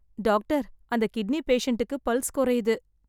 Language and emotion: Tamil, sad